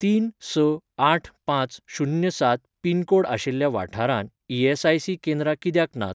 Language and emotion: Goan Konkani, neutral